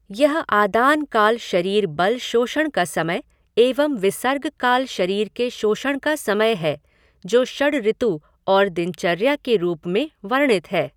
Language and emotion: Hindi, neutral